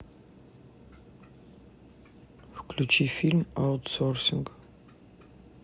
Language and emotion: Russian, neutral